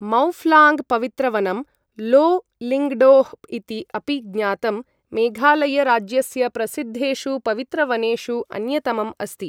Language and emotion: Sanskrit, neutral